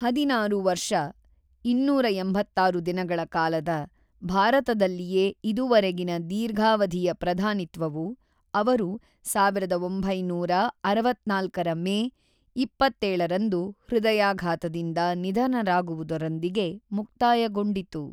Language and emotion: Kannada, neutral